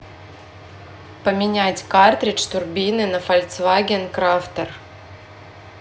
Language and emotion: Russian, neutral